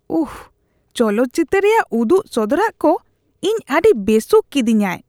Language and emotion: Santali, disgusted